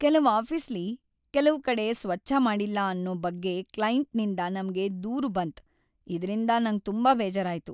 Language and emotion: Kannada, sad